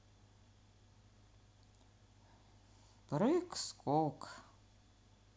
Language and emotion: Russian, sad